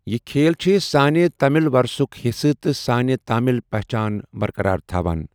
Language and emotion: Kashmiri, neutral